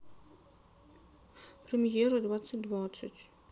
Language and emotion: Russian, sad